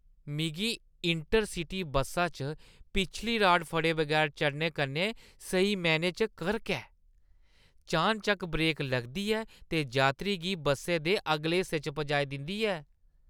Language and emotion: Dogri, disgusted